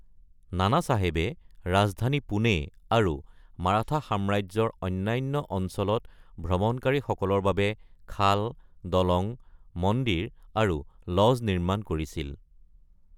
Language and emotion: Assamese, neutral